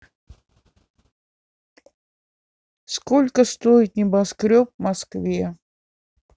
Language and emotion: Russian, neutral